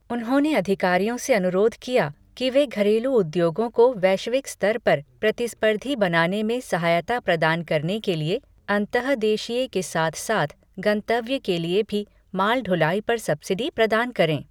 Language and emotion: Hindi, neutral